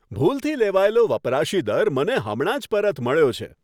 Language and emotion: Gujarati, happy